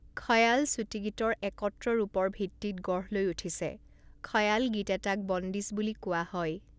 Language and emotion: Assamese, neutral